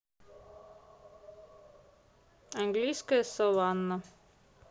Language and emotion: Russian, neutral